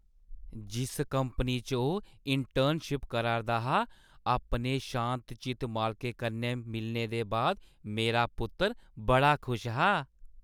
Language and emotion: Dogri, happy